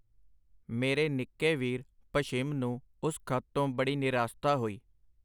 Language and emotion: Punjabi, neutral